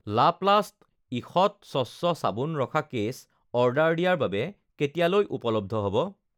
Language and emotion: Assamese, neutral